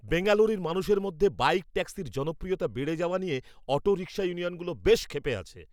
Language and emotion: Bengali, angry